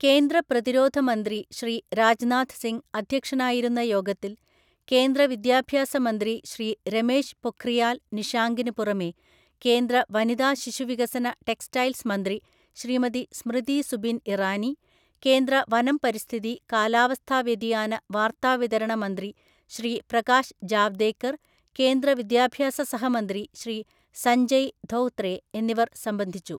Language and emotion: Malayalam, neutral